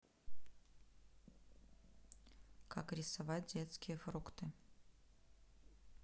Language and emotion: Russian, neutral